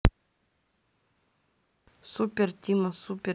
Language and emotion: Russian, neutral